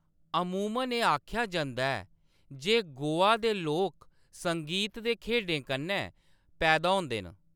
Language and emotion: Dogri, neutral